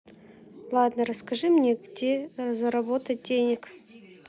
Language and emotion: Russian, neutral